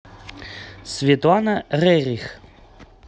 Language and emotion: Russian, neutral